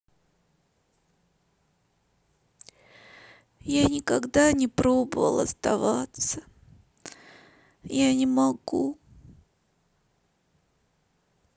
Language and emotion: Russian, sad